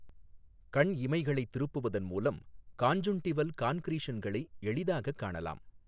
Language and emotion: Tamil, neutral